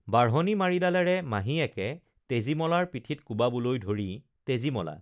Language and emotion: Assamese, neutral